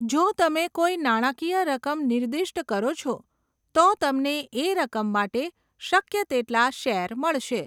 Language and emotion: Gujarati, neutral